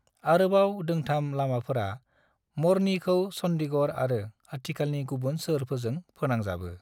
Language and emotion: Bodo, neutral